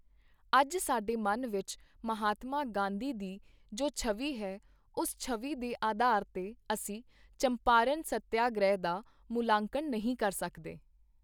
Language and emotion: Punjabi, neutral